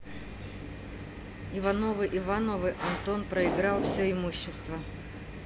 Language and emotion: Russian, neutral